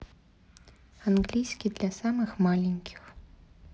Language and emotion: Russian, neutral